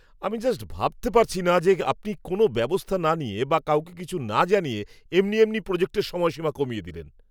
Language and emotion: Bengali, angry